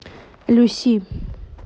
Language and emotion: Russian, neutral